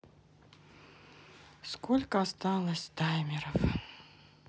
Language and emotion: Russian, sad